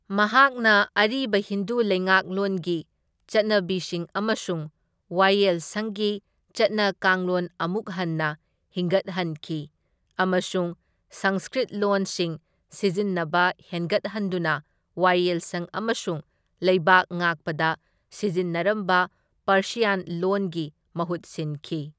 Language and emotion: Manipuri, neutral